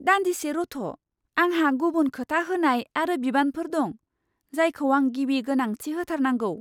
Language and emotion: Bodo, surprised